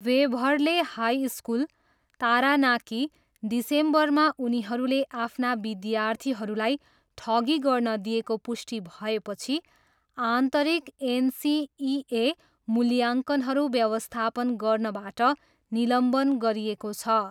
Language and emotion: Nepali, neutral